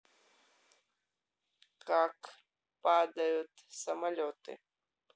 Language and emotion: Russian, neutral